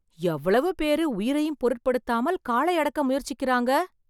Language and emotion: Tamil, surprised